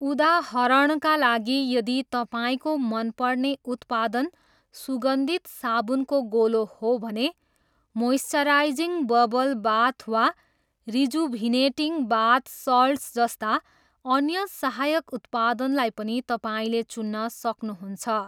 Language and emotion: Nepali, neutral